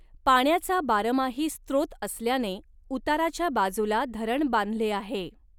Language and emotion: Marathi, neutral